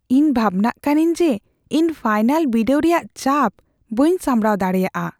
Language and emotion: Santali, fearful